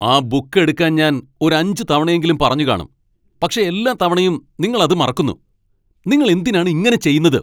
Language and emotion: Malayalam, angry